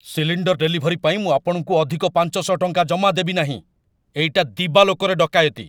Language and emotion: Odia, angry